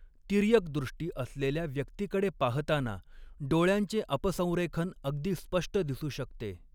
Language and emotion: Marathi, neutral